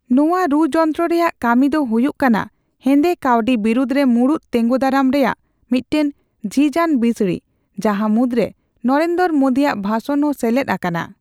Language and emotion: Santali, neutral